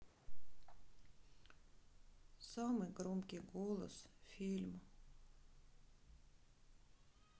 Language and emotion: Russian, sad